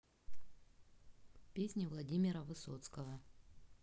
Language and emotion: Russian, neutral